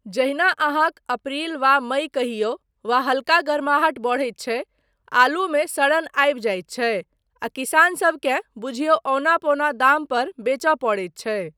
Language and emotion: Maithili, neutral